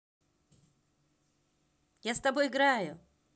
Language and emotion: Russian, positive